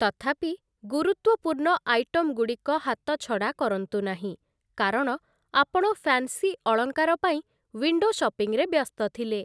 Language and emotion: Odia, neutral